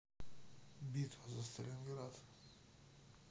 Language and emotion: Russian, neutral